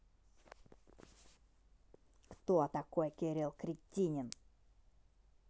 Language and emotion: Russian, angry